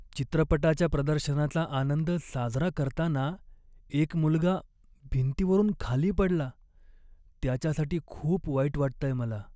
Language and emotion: Marathi, sad